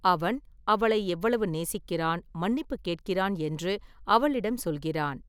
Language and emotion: Tamil, neutral